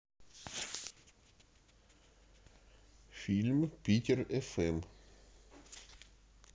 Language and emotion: Russian, neutral